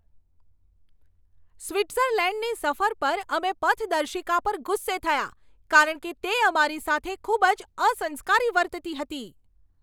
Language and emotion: Gujarati, angry